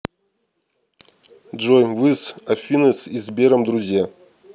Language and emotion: Russian, neutral